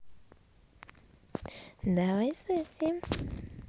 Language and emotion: Russian, positive